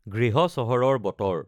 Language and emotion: Assamese, neutral